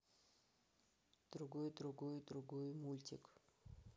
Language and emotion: Russian, neutral